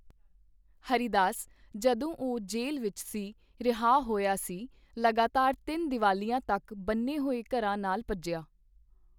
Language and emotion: Punjabi, neutral